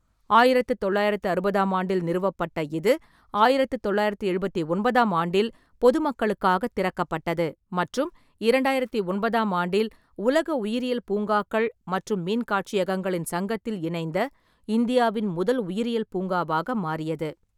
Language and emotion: Tamil, neutral